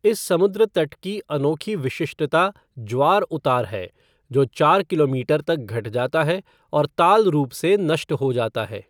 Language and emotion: Hindi, neutral